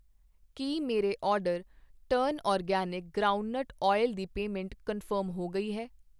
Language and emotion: Punjabi, neutral